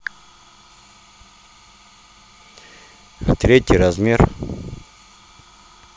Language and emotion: Russian, neutral